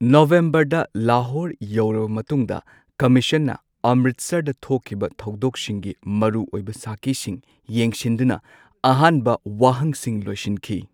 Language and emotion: Manipuri, neutral